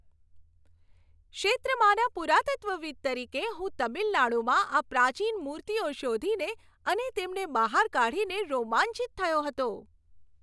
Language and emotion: Gujarati, happy